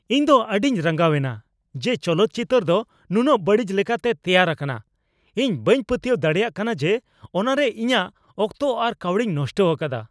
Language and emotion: Santali, angry